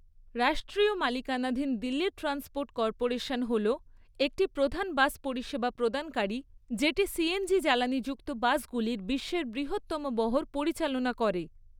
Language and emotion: Bengali, neutral